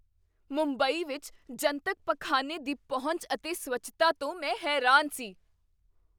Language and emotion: Punjabi, surprised